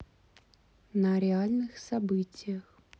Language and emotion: Russian, neutral